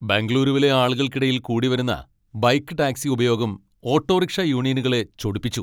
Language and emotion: Malayalam, angry